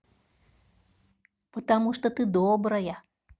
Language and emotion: Russian, positive